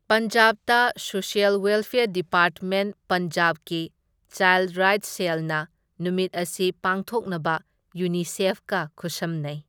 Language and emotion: Manipuri, neutral